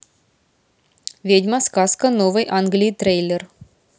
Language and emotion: Russian, neutral